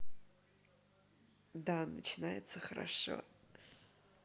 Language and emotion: Russian, positive